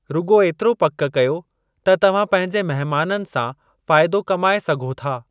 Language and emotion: Sindhi, neutral